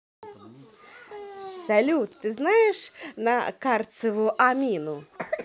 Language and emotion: Russian, positive